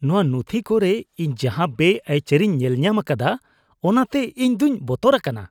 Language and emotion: Santali, disgusted